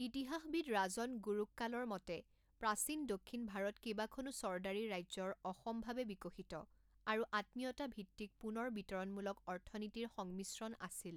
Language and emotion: Assamese, neutral